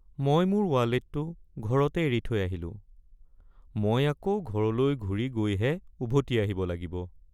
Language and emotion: Assamese, sad